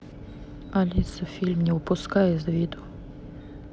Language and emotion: Russian, neutral